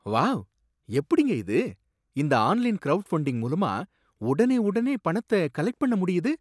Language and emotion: Tamil, surprised